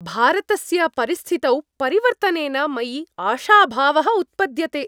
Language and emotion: Sanskrit, happy